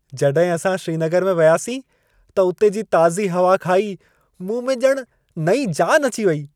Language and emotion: Sindhi, happy